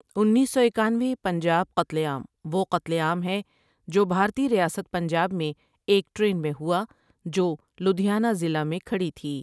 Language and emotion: Urdu, neutral